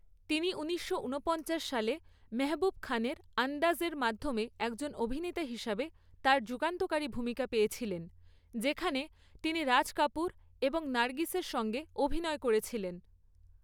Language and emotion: Bengali, neutral